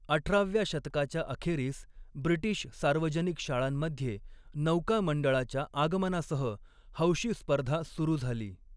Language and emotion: Marathi, neutral